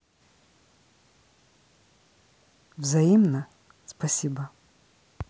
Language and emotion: Russian, neutral